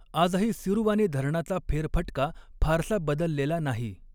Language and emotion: Marathi, neutral